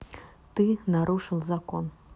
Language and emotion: Russian, neutral